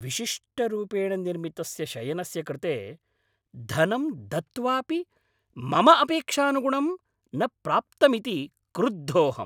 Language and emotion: Sanskrit, angry